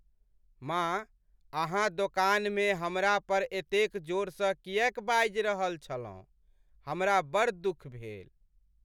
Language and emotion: Maithili, sad